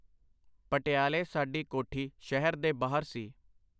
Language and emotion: Punjabi, neutral